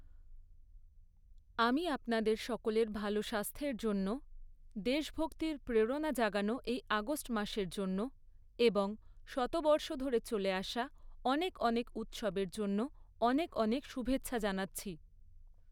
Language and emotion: Bengali, neutral